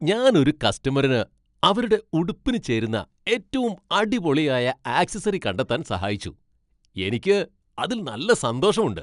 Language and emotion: Malayalam, happy